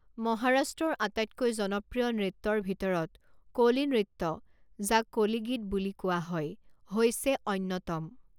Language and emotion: Assamese, neutral